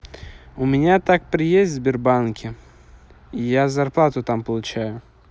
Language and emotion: Russian, neutral